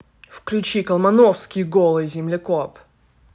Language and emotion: Russian, angry